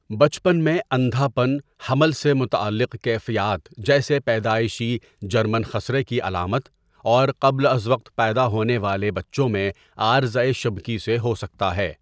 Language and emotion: Urdu, neutral